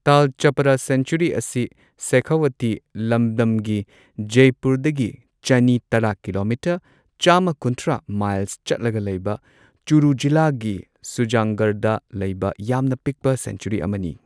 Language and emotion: Manipuri, neutral